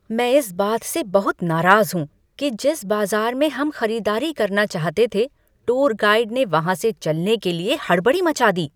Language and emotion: Hindi, angry